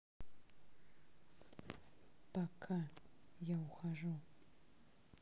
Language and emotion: Russian, sad